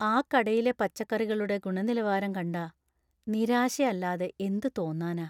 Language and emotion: Malayalam, sad